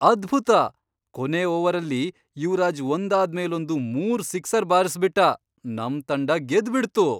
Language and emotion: Kannada, surprised